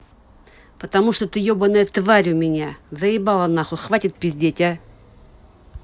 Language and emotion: Russian, angry